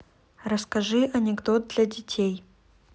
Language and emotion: Russian, neutral